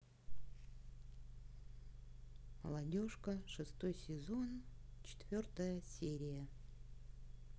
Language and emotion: Russian, neutral